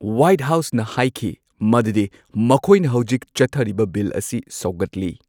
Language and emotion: Manipuri, neutral